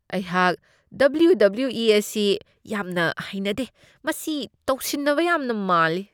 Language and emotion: Manipuri, disgusted